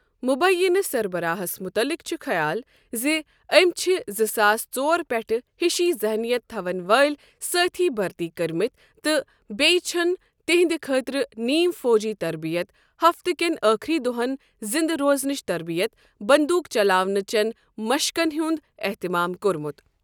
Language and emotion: Kashmiri, neutral